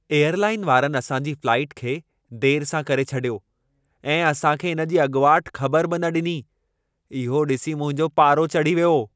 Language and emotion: Sindhi, angry